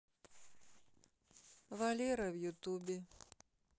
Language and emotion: Russian, neutral